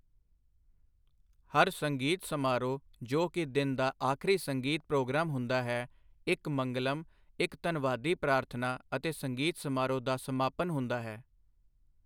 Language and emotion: Punjabi, neutral